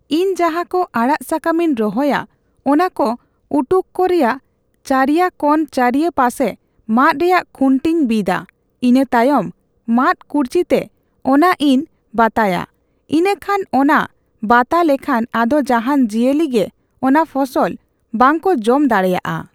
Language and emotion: Santali, neutral